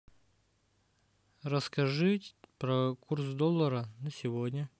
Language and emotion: Russian, neutral